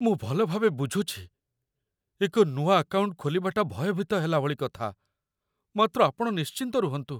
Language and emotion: Odia, fearful